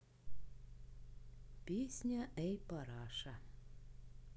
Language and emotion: Russian, neutral